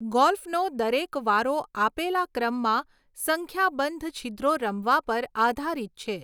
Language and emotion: Gujarati, neutral